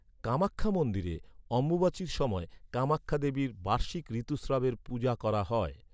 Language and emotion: Bengali, neutral